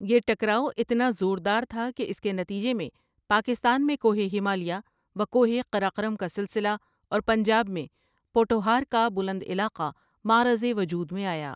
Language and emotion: Urdu, neutral